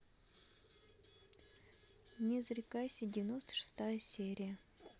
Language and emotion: Russian, neutral